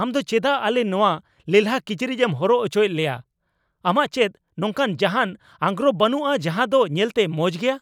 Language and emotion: Santali, angry